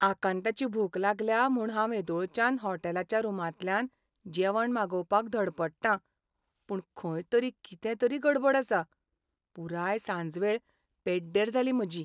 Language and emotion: Goan Konkani, sad